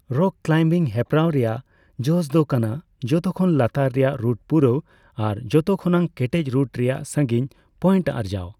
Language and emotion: Santali, neutral